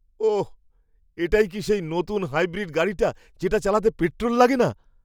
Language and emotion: Bengali, surprised